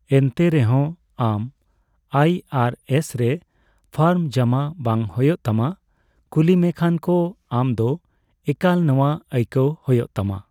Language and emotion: Santali, neutral